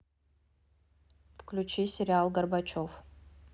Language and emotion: Russian, neutral